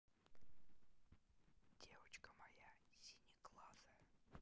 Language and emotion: Russian, neutral